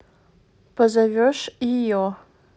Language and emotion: Russian, neutral